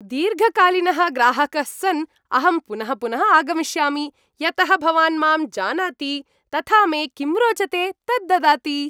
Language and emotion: Sanskrit, happy